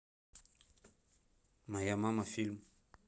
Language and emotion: Russian, neutral